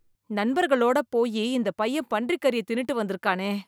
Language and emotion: Tamil, disgusted